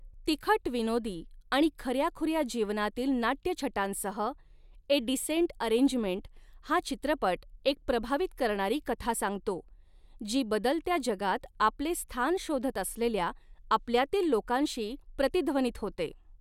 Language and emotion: Marathi, neutral